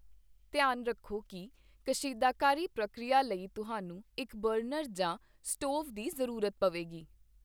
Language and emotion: Punjabi, neutral